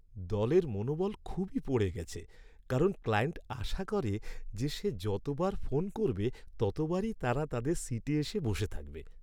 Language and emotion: Bengali, sad